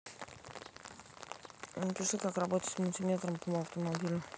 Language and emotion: Russian, neutral